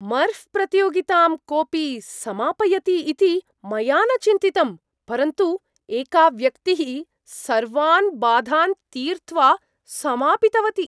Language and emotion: Sanskrit, surprised